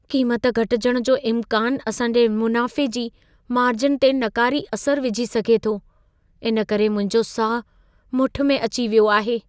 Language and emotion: Sindhi, fearful